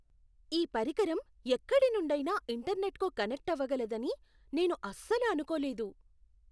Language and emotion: Telugu, surprised